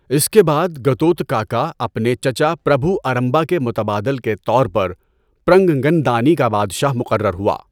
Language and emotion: Urdu, neutral